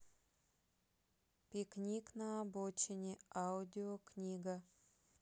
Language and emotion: Russian, neutral